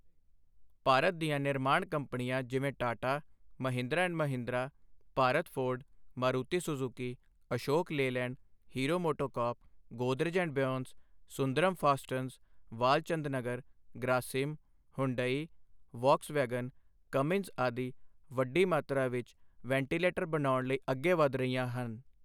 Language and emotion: Punjabi, neutral